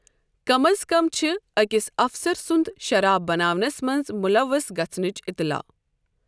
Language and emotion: Kashmiri, neutral